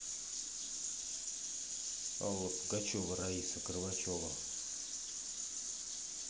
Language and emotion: Russian, neutral